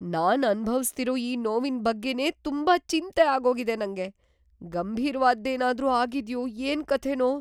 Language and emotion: Kannada, fearful